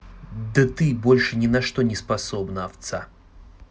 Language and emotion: Russian, angry